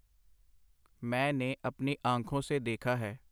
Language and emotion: Punjabi, neutral